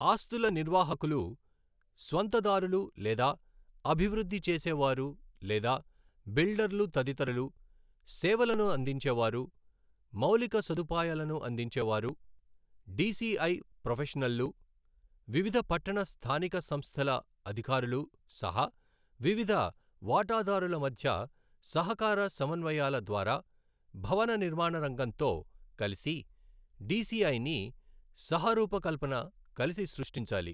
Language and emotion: Telugu, neutral